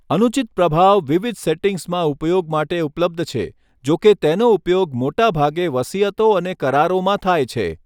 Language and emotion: Gujarati, neutral